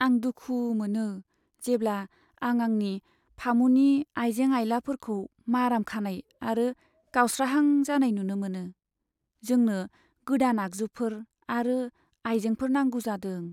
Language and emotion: Bodo, sad